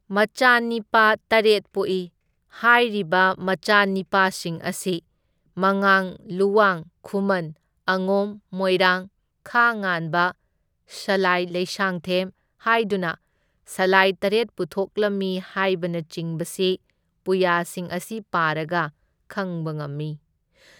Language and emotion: Manipuri, neutral